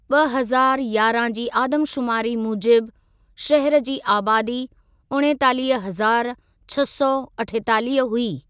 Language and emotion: Sindhi, neutral